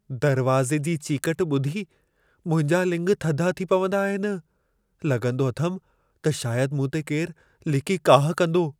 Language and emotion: Sindhi, fearful